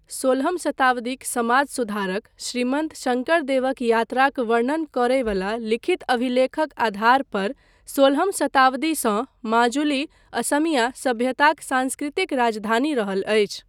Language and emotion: Maithili, neutral